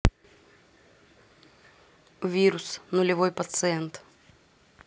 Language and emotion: Russian, neutral